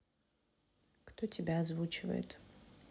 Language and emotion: Russian, neutral